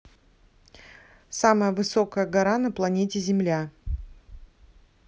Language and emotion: Russian, neutral